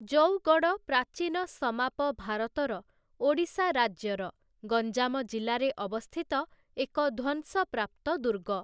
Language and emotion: Odia, neutral